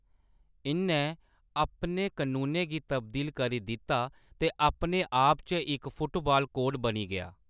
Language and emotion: Dogri, neutral